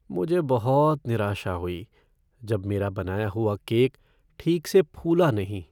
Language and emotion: Hindi, sad